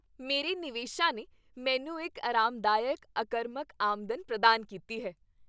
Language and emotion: Punjabi, happy